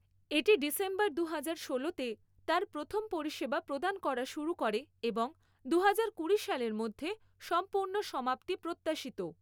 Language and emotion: Bengali, neutral